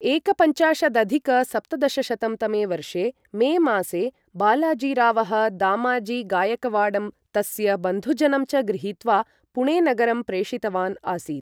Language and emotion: Sanskrit, neutral